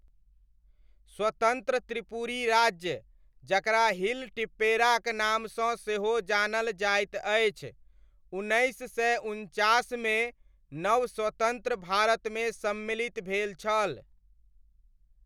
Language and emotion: Maithili, neutral